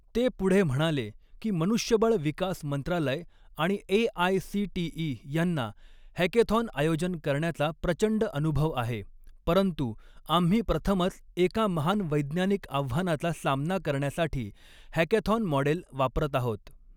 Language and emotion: Marathi, neutral